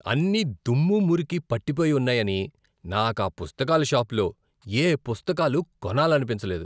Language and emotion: Telugu, disgusted